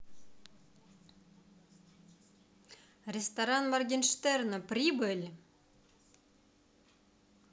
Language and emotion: Russian, positive